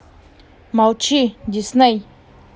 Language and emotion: Russian, angry